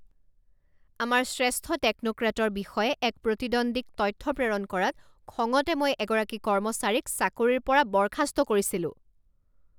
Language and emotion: Assamese, angry